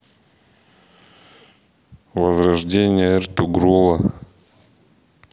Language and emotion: Russian, neutral